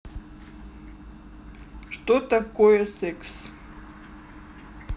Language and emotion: Russian, neutral